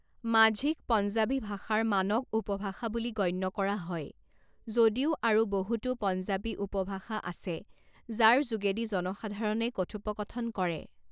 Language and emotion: Assamese, neutral